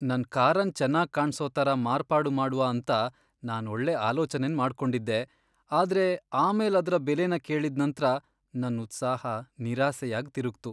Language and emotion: Kannada, sad